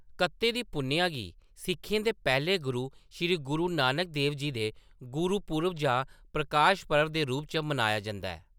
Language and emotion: Dogri, neutral